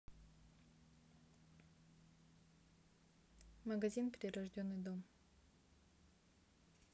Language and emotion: Russian, neutral